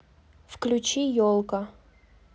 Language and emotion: Russian, neutral